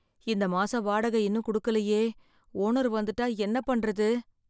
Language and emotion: Tamil, fearful